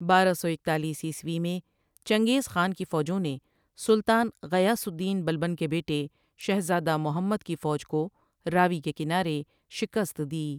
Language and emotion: Urdu, neutral